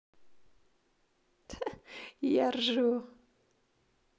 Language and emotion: Russian, positive